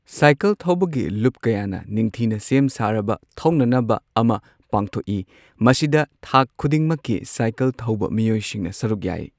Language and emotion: Manipuri, neutral